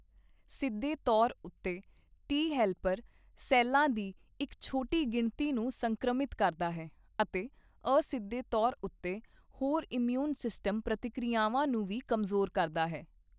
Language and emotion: Punjabi, neutral